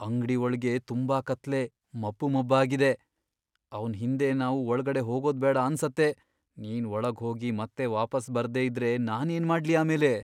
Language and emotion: Kannada, fearful